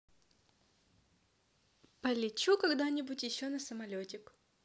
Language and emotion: Russian, positive